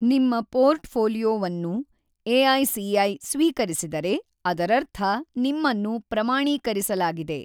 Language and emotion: Kannada, neutral